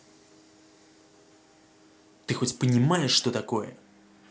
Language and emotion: Russian, angry